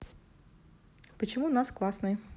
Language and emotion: Russian, neutral